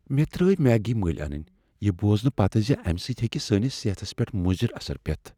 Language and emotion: Kashmiri, fearful